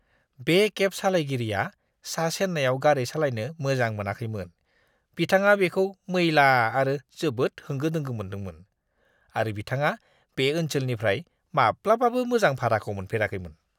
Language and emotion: Bodo, disgusted